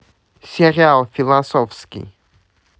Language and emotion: Russian, neutral